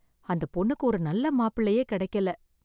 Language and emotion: Tamil, sad